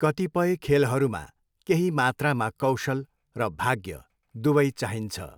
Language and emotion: Nepali, neutral